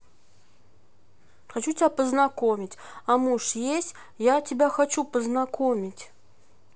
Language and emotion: Russian, neutral